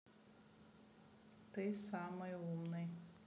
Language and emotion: Russian, neutral